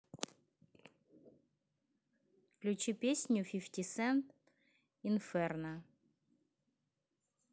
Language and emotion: Russian, neutral